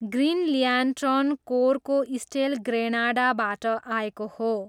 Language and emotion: Nepali, neutral